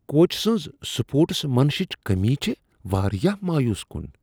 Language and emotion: Kashmiri, disgusted